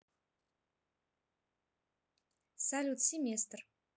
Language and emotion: Russian, neutral